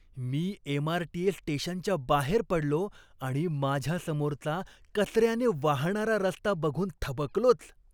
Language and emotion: Marathi, disgusted